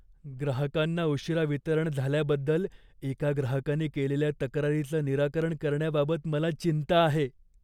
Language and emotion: Marathi, fearful